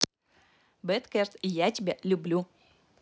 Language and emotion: Russian, positive